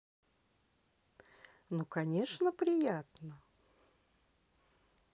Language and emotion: Russian, positive